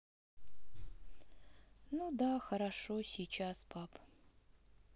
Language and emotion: Russian, sad